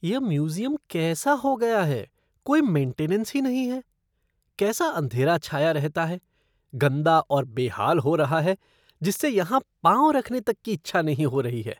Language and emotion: Hindi, disgusted